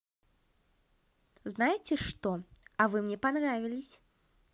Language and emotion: Russian, positive